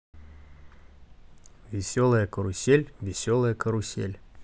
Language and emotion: Russian, neutral